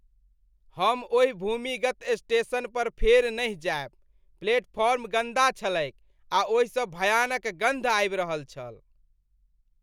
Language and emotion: Maithili, disgusted